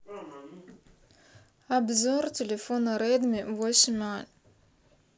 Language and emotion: Russian, neutral